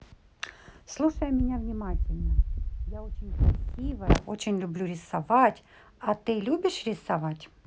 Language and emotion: Russian, neutral